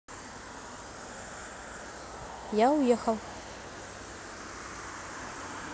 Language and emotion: Russian, neutral